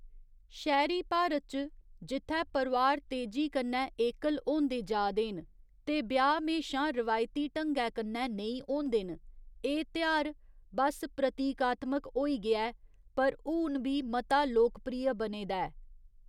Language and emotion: Dogri, neutral